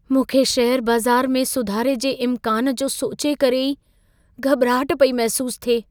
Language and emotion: Sindhi, fearful